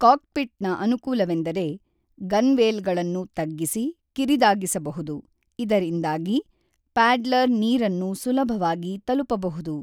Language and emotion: Kannada, neutral